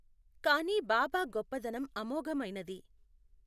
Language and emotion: Telugu, neutral